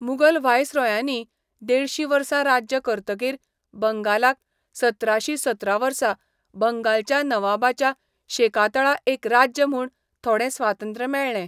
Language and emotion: Goan Konkani, neutral